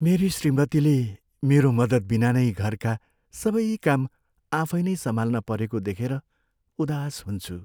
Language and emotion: Nepali, sad